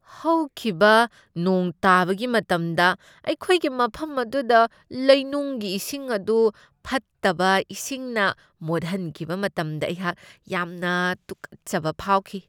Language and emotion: Manipuri, disgusted